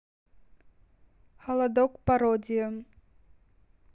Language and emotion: Russian, neutral